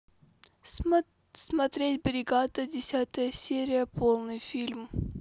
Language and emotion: Russian, neutral